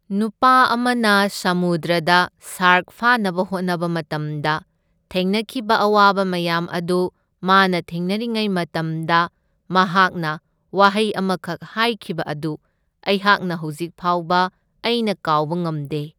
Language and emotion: Manipuri, neutral